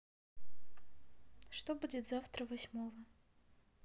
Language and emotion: Russian, neutral